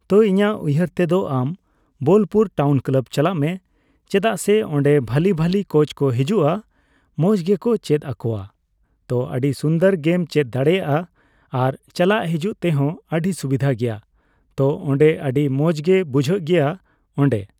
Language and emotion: Santali, neutral